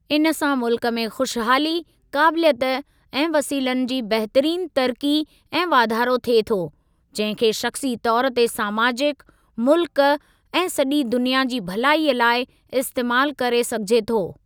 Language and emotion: Sindhi, neutral